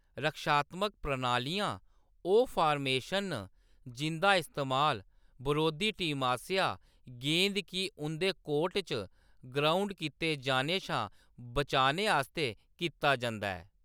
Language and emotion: Dogri, neutral